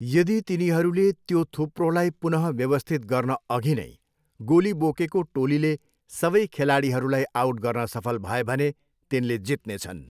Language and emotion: Nepali, neutral